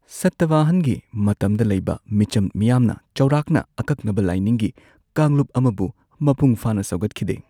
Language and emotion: Manipuri, neutral